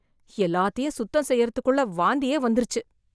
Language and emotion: Tamil, disgusted